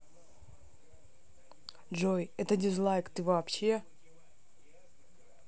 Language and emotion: Russian, neutral